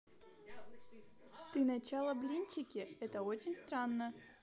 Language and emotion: Russian, positive